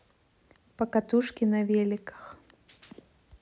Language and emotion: Russian, neutral